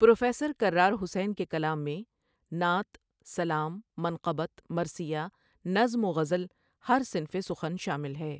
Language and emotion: Urdu, neutral